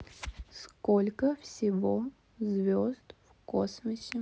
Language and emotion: Russian, neutral